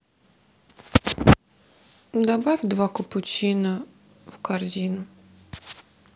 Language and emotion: Russian, sad